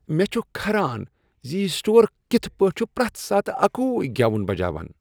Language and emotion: Kashmiri, disgusted